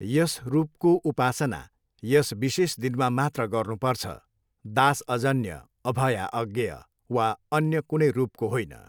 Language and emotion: Nepali, neutral